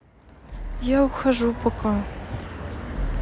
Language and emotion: Russian, sad